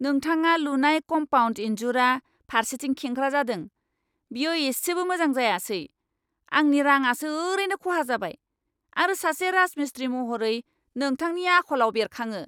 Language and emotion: Bodo, angry